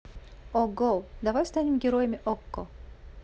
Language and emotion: Russian, positive